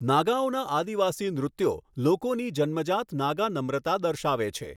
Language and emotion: Gujarati, neutral